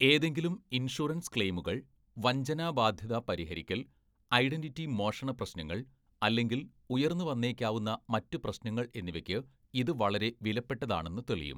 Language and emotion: Malayalam, neutral